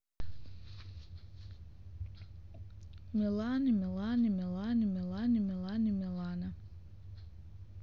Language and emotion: Russian, neutral